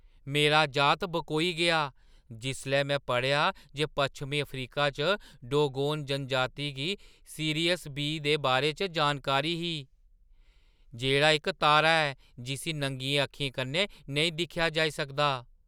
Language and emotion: Dogri, surprised